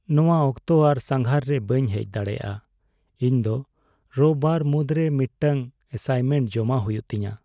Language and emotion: Santali, sad